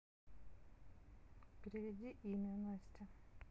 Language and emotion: Russian, neutral